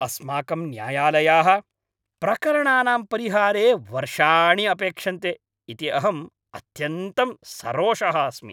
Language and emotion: Sanskrit, angry